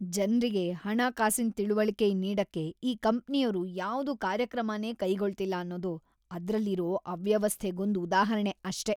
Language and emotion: Kannada, disgusted